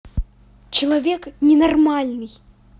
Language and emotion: Russian, angry